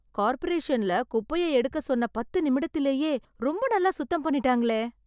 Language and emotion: Tamil, surprised